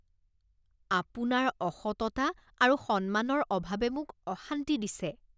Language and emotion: Assamese, disgusted